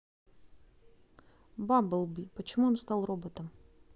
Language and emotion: Russian, neutral